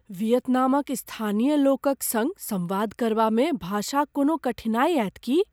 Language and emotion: Maithili, fearful